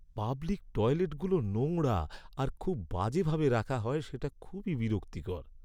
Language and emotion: Bengali, sad